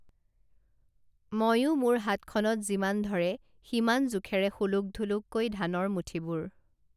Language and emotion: Assamese, neutral